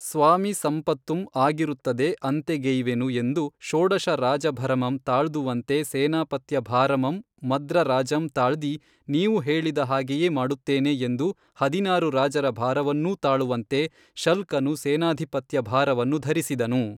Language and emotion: Kannada, neutral